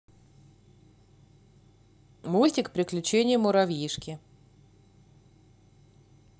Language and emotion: Russian, positive